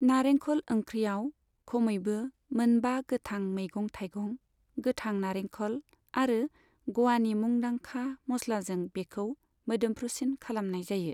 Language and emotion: Bodo, neutral